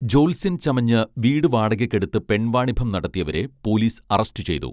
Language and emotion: Malayalam, neutral